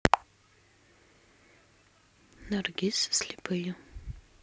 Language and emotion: Russian, neutral